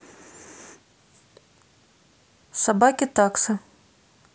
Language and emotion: Russian, neutral